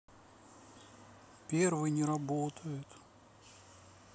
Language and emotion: Russian, sad